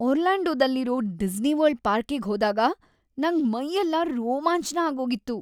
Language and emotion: Kannada, happy